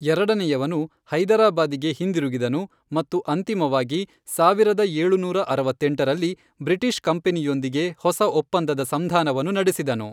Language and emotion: Kannada, neutral